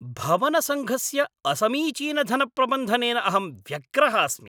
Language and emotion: Sanskrit, angry